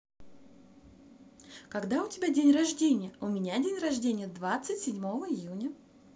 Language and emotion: Russian, positive